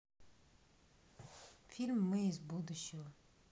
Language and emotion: Russian, neutral